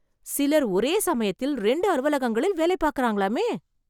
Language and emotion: Tamil, surprised